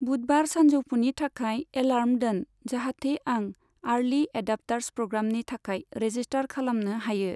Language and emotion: Bodo, neutral